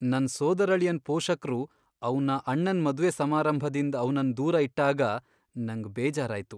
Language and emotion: Kannada, sad